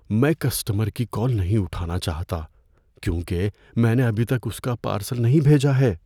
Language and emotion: Urdu, fearful